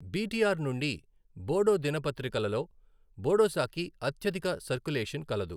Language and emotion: Telugu, neutral